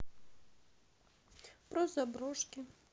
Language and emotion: Russian, sad